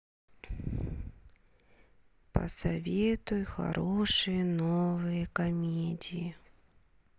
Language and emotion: Russian, sad